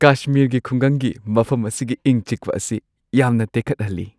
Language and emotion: Manipuri, happy